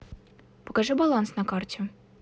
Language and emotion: Russian, neutral